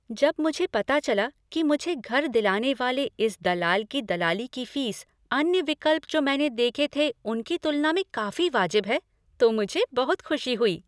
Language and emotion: Hindi, happy